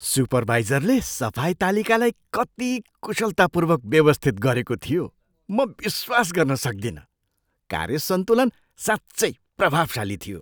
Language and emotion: Nepali, surprised